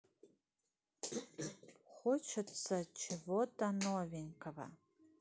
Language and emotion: Russian, neutral